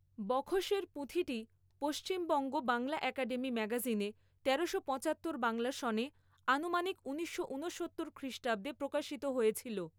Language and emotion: Bengali, neutral